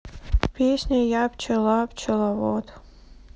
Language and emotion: Russian, sad